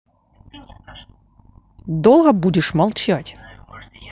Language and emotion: Russian, angry